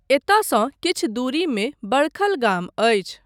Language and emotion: Maithili, neutral